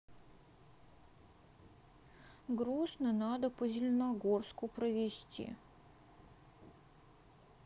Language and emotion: Russian, sad